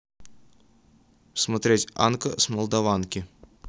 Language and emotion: Russian, neutral